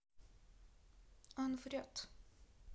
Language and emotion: Russian, neutral